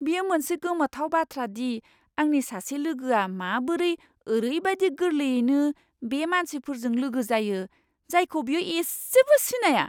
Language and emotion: Bodo, surprised